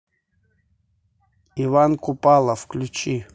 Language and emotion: Russian, neutral